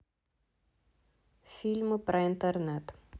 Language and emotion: Russian, neutral